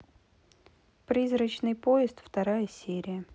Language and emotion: Russian, neutral